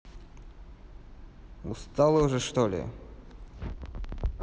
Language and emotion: Russian, neutral